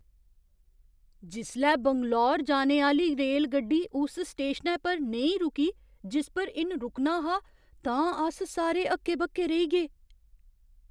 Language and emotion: Dogri, surprised